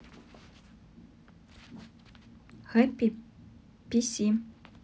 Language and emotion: Russian, neutral